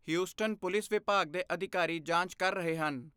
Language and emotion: Punjabi, neutral